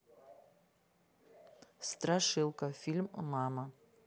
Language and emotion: Russian, neutral